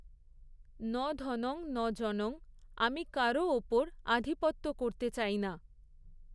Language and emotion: Bengali, neutral